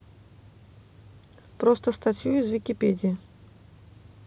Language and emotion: Russian, neutral